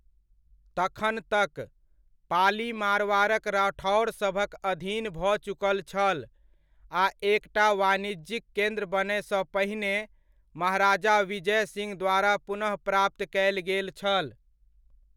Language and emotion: Maithili, neutral